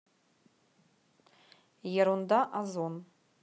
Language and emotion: Russian, neutral